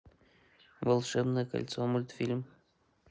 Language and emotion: Russian, neutral